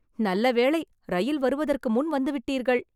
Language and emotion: Tamil, happy